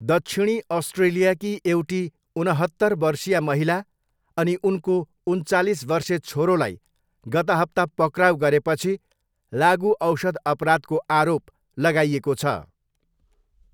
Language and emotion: Nepali, neutral